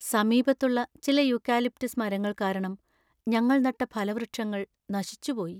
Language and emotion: Malayalam, sad